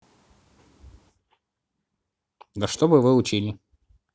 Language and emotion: Russian, neutral